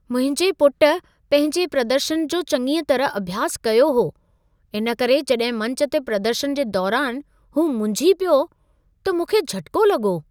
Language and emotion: Sindhi, surprised